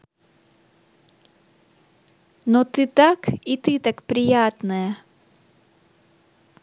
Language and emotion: Russian, positive